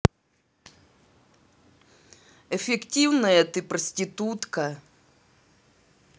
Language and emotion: Russian, neutral